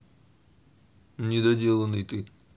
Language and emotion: Russian, neutral